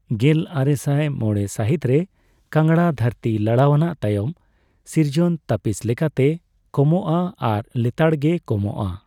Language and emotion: Santali, neutral